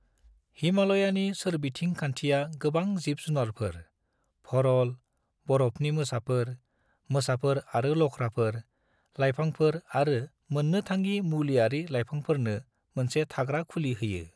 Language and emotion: Bodo, neutral